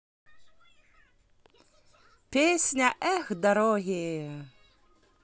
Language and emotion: Russian, positive